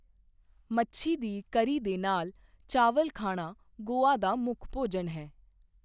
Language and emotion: Punjabi, neutral